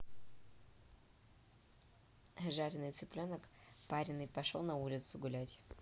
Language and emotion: Russian, neutral